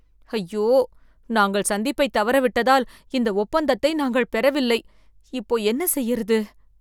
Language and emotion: Tamil, fearful